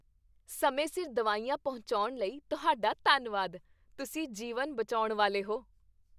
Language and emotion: Punjabi, happy